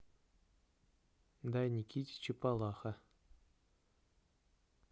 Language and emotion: Russian, neutral